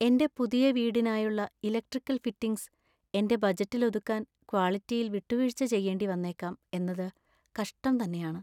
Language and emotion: Malayalam, sad